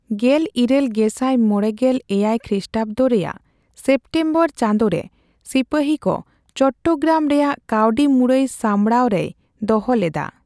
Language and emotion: Santali, neutral